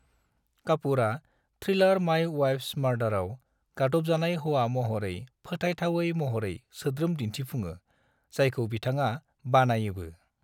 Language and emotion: Bodo, neutral